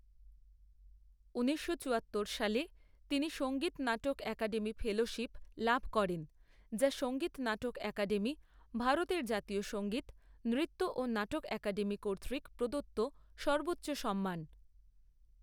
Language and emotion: Bengali, neutral